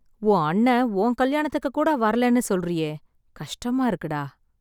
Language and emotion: Tamil, sad